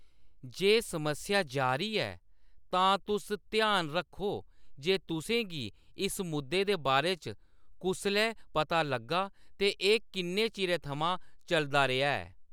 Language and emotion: Dogri, neutral